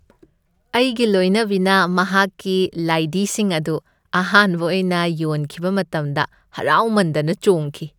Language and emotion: Manipuri, happy